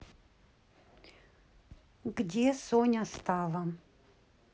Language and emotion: Russian, neutral